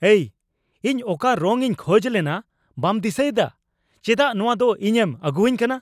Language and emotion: Santali, angry